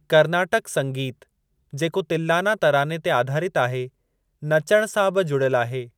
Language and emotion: Sindhi, neutral